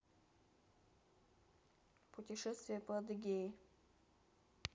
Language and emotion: Russian, neutral